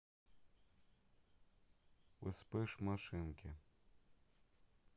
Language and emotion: Russian, neutral